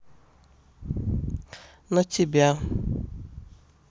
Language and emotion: Russian, neutral